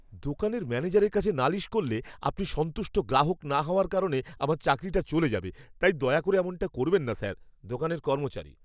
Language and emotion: Bengali, fearful